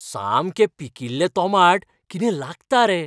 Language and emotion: Goan Konkani, happy